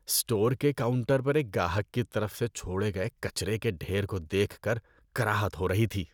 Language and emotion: Urdu, disgusted